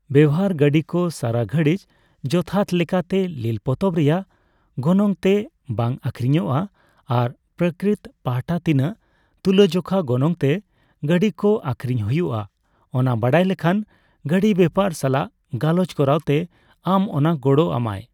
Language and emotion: Santali, neutral